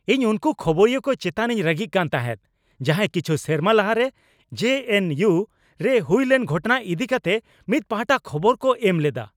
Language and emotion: Santali, angry